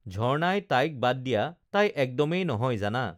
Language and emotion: Assamese, neutral